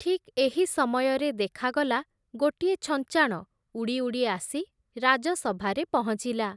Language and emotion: Odia, neutral